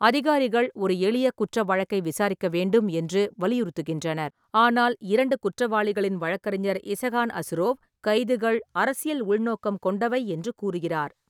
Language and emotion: Tamil, neutral